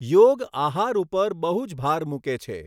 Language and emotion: Gujarati, neutral